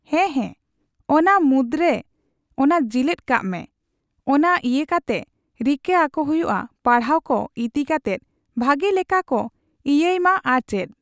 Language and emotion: Santali, neutral